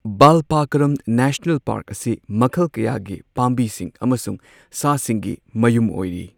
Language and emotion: Manipuri, neutral